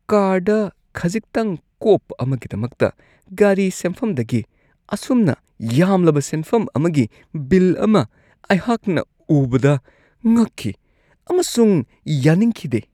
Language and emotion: Manipuri, disgusted